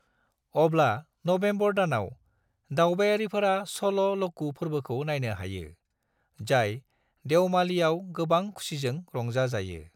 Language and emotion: Bodo, neutral